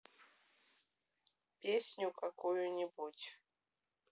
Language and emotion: Russian, neutral